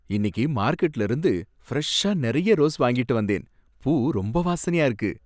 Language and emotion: Tamil, happy